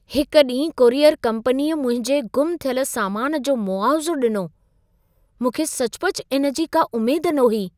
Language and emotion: Sindhi, surprised